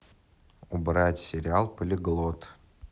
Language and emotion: Russian, neutral